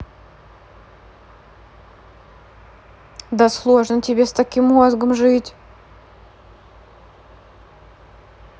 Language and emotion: Russian, neutral